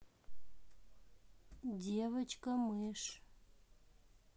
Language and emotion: Russian, neutral